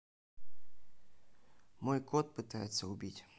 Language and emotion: Russian, neutral